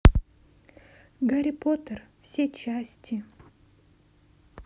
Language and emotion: Russian, sad